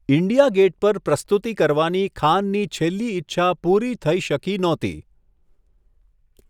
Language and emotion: Gujarati, neutral